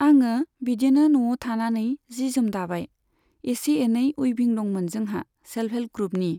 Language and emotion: Bodo, neutral